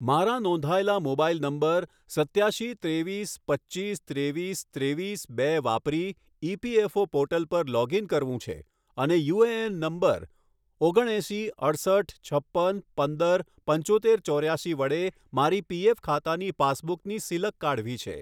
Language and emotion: Gujarati, neutral